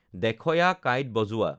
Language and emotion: Assamese, neutral